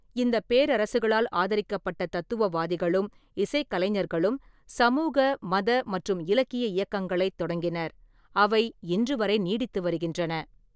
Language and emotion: Tamil, neutral